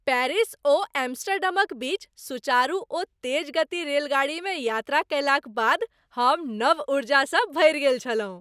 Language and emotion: Maithili, happy